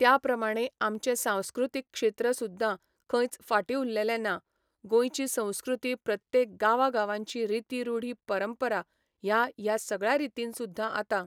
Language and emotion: Goan Konkani, neutral